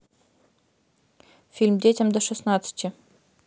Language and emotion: Russian, neutral